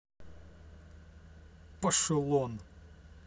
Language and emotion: Russian, angry